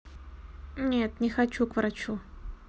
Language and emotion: Russian, neutral